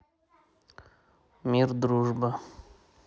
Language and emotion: Russian, neutral